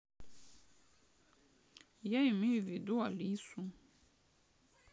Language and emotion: Russian, sad